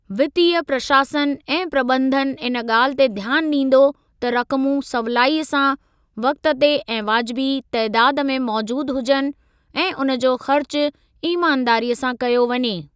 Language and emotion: Sindhi, neutral